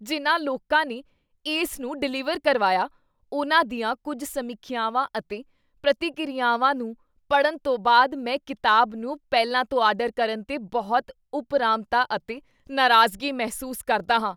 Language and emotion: Punjabi, disgusted